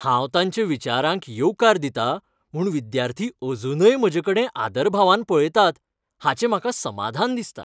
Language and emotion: Goan Konkani, happy